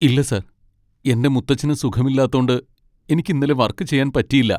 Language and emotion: Malayalam, sad